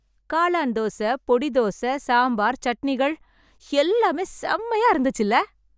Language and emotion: Tamil, happy